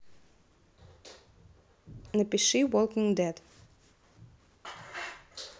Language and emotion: Russian, neutral